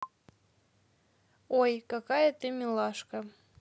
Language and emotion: Russian, positive